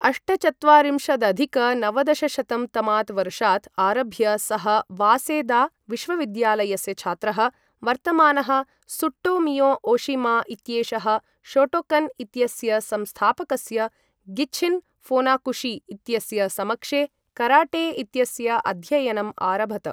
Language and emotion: Sanskrit, neutral